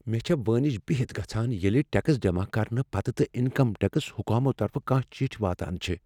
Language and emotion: Kashmiri, fearful